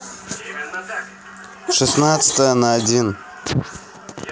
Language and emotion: Russian, neutral